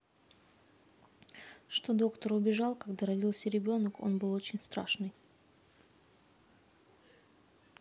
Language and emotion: Russian, neutral